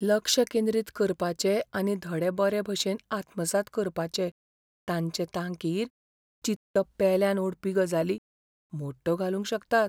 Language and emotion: Goan Konkani, fearful